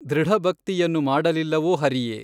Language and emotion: Kannada, neutral